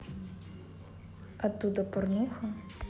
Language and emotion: Russian, neutral